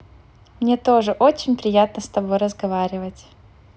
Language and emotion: Russian, positive